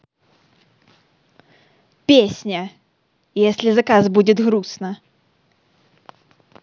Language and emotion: Russian, positive